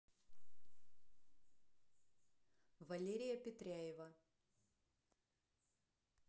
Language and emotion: Russian, neutral